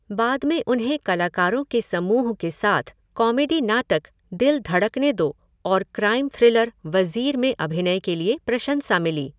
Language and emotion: Hindi, neutral